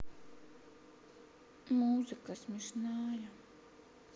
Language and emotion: Russian, sad